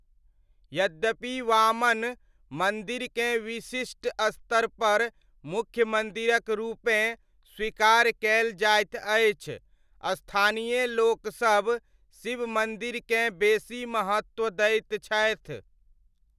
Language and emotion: Maithili, neutral